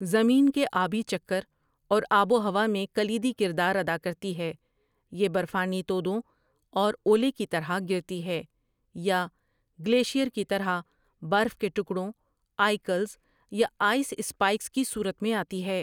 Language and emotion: Urdu, neutral